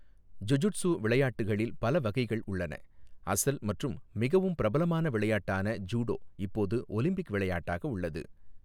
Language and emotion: Tamil, neutral